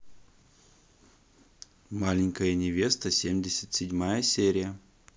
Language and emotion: Russian, positive